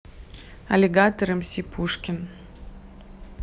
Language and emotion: Russian, neutral